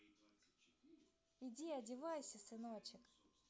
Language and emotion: Russian, neutral